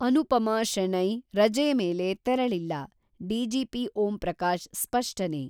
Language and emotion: Kannada, neutral